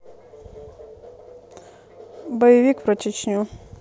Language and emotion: Russian, neutral